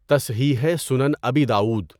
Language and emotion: Urdu, neutral